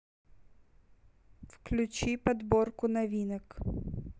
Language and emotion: Russian, neutral